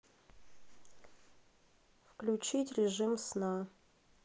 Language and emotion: Russian, neutral